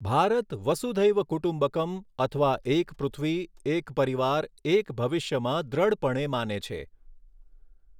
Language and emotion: Gujarati, neutral